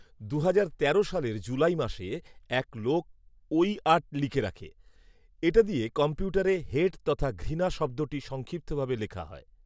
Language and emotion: Bengali, neutral